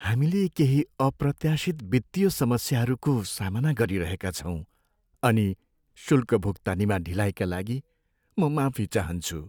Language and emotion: Nepali, sad